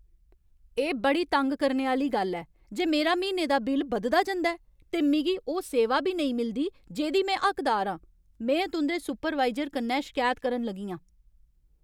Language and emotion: Dogri, angry